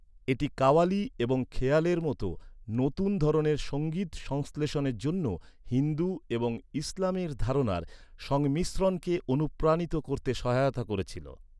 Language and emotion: Bengali, neutral